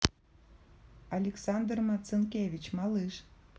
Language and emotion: Russian, neutral